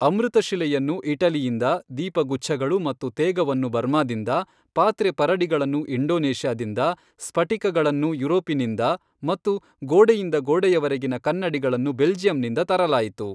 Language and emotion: Kannada, neutral